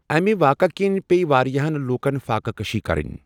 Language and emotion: Kashmiri, neutral